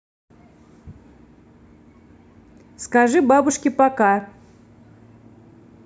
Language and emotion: Russian, neutral